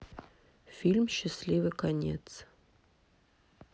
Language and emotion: Russian, neutral